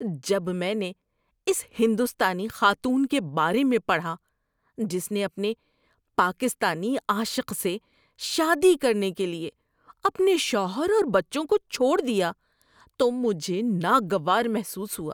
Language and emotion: Urdu, disgusted